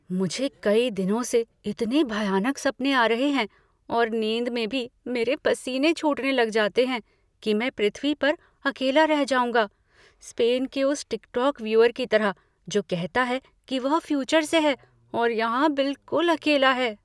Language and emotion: Hindi, fearful